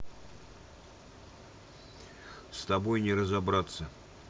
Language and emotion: Russian, neutral